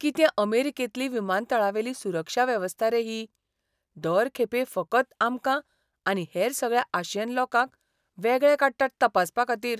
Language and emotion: Goan Konkani, disgusted